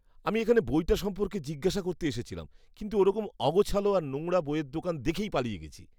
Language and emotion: Bengali, disgusted